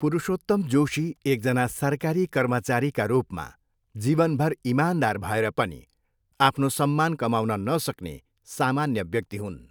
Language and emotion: Nepali, neutral